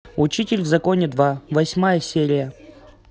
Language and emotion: Russian, neutral